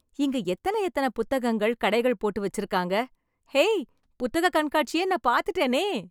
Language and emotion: Tamil, happy